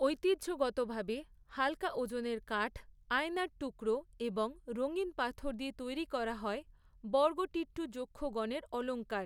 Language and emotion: Bengali, neutral